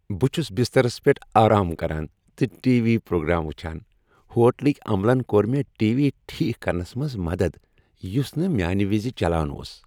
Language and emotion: Kashmiri, happy